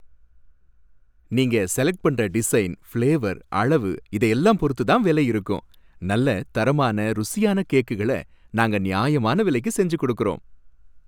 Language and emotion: Tamil, happy